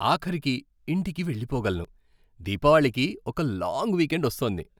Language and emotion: Telugu, happy